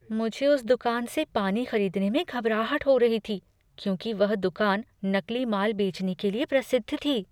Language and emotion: Hindi, fearful